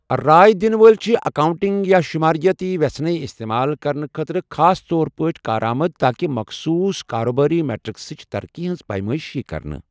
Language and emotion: Kashmiri, neutral